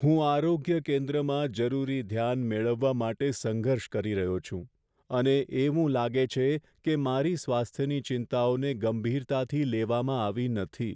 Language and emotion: Gujarati, sad